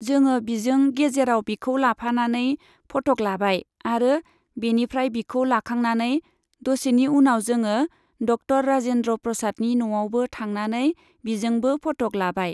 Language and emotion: Bodo, neutral